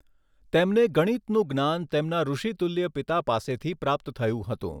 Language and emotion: Gujarati, neutral